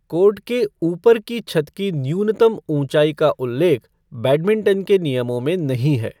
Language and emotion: Hindi, neutral